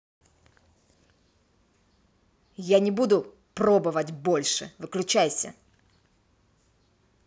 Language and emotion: Russian, angry